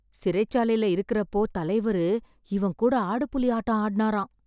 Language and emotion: Tamil, surprised